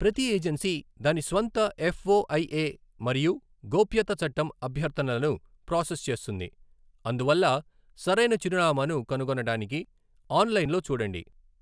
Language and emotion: Telugu, neutral